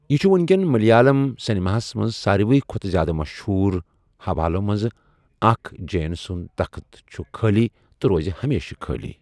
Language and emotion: Kashmiri, neutral